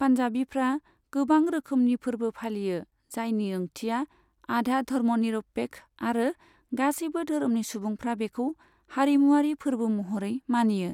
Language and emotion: Bodo, neutral